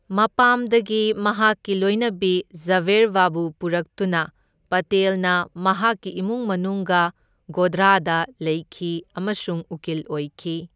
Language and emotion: Manipuri, neutral